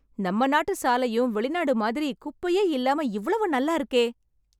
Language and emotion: Tamil, happy